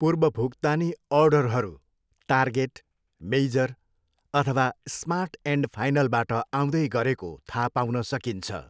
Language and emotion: Nepali, neutral